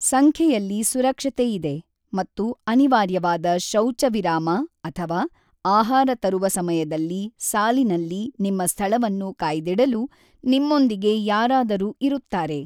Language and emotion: Kannada, neutral